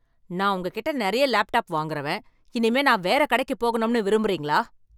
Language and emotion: Tamil, angry